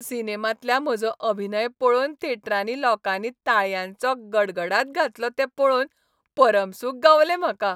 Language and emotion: Goan Konkani, happy